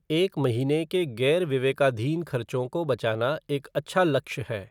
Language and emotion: Hindi, neutral